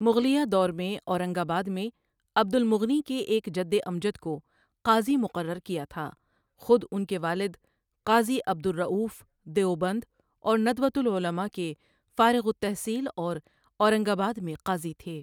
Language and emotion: Urdu, neutral